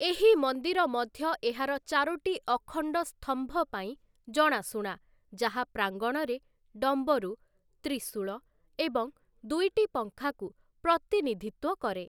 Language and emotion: Odia, neutral